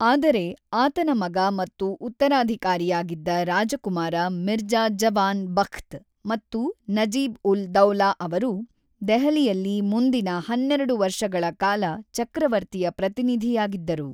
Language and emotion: Kannada, neutral